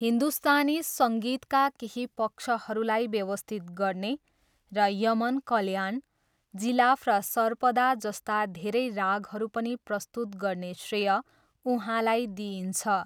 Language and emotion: Nepali, neutral